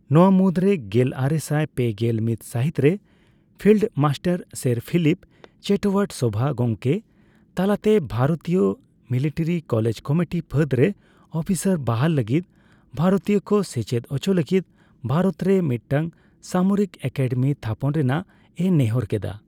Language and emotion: Santali, neutral